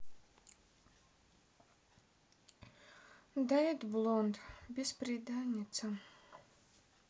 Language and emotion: Russian, sad